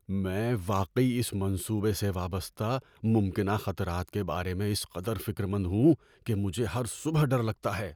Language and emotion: Urdu, fearful